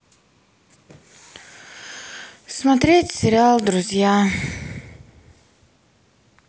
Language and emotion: Russian, sad